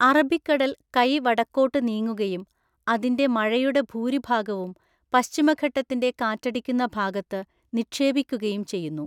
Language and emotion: Malayalam, neutral